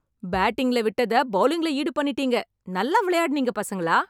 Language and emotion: Tamil, happy